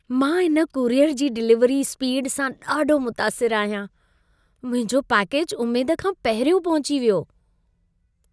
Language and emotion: Sindhi, happy